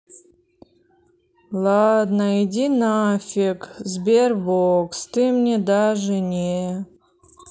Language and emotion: Russian, sad